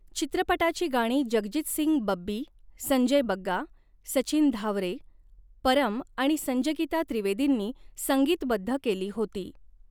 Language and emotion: Marathi, neutral